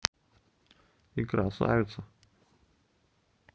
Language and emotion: Russian, neutral